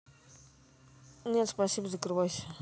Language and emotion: Russian, neutral